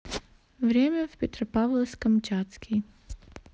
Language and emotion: Russian, neutral